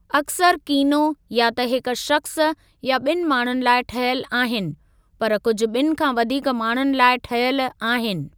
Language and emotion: Sindhi, neutral